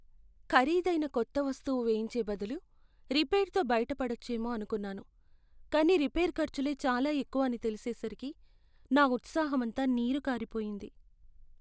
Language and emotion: Telugu, sad